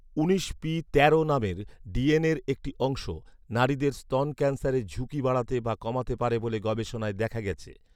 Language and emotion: Bengali, neutral